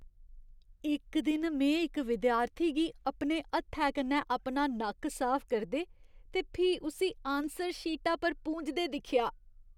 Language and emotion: Dogri, disgusted